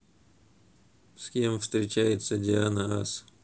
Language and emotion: Russian, neutral